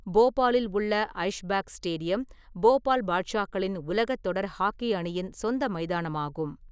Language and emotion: Tamil, neutral